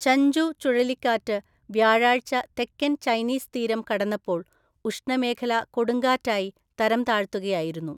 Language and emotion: Malayalam, neutral